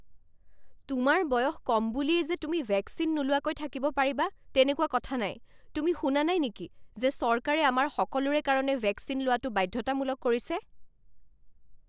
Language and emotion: Assamese, angry